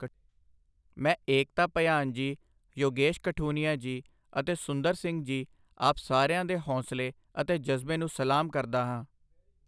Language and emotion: Punjabi, neutral